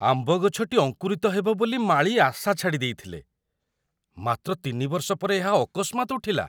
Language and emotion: Odia, surprised